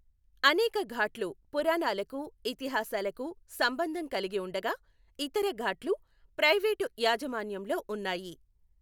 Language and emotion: Telugu, neutral